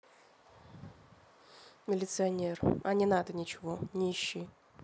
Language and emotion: Russian, neutral